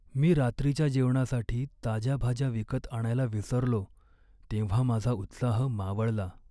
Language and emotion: Marathi, sad